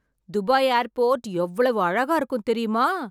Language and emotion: Tamil, surprised